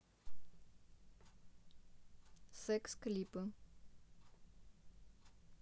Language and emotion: Russian, neutral